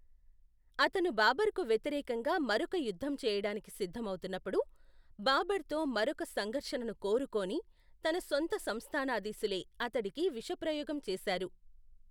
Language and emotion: Telugu, neutral